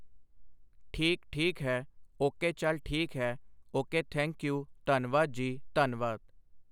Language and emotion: Punjabi, neutral